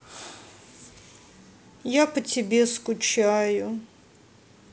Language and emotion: Russian, sad